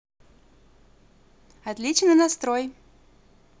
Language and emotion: Russian, positive